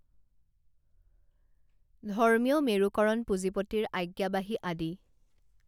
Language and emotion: Assamese, neutral